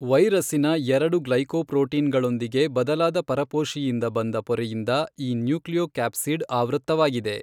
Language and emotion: Kannada, neutral